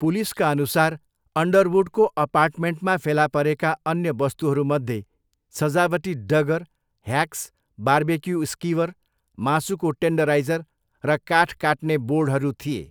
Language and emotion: Nepali, neutral